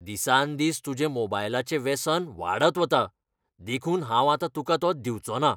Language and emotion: Goan Konkani, angry